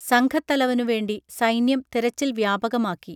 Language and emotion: Malayalam, neutral